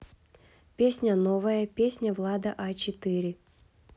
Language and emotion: Russian, neutral